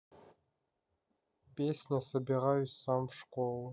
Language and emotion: Russian, neutral